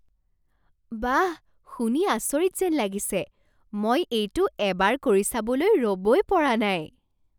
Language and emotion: Assamese, surprised